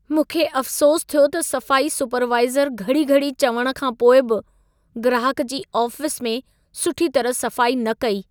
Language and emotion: Sindhi, sad